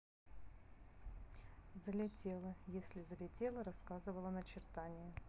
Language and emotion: Russian, neutral